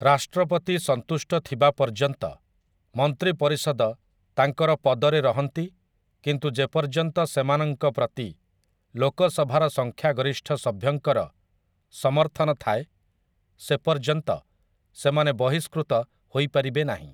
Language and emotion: Odia, neutral